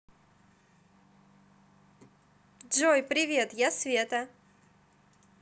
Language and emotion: Russian, positive